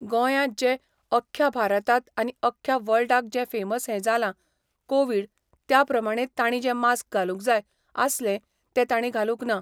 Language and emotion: Goan Konkani, neutral